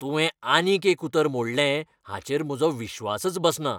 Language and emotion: Goan Konkani, angry